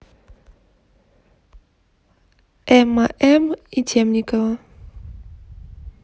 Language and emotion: Russian, neutral